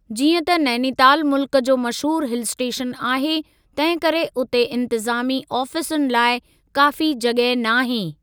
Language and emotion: Sindhi, neutral